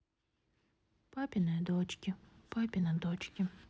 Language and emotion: Russian, sad